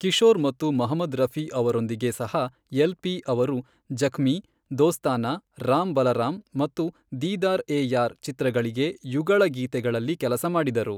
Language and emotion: Kannada, neutral